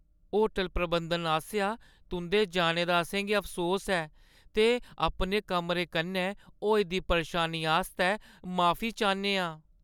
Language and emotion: Dogri, sad